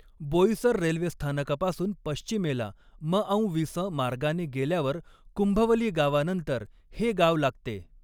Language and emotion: Marathi, neutral